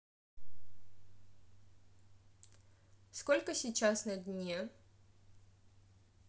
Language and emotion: Russian, neutral